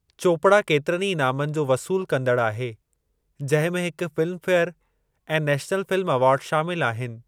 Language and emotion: Sindhi, neutral